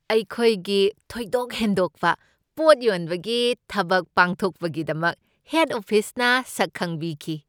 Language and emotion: Manipuri, happy